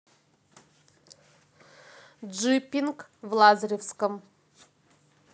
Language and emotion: Russian, neutral